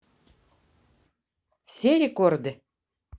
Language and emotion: Russian, neutral